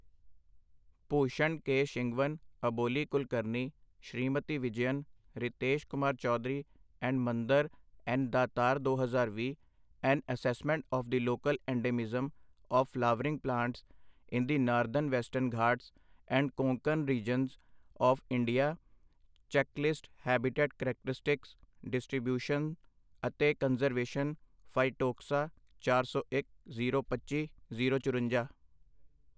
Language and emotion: Punjabi, neutral